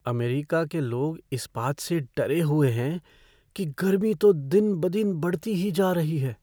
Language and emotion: Hindi, fearful